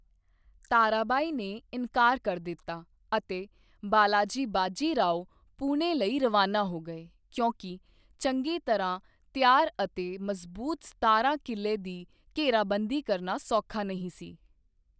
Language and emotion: Punjabi, neutral